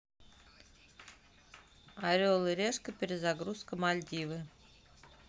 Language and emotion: Russian, neutral